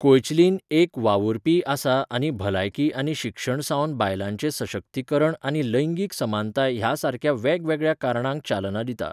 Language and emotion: Goan Konkani, neutral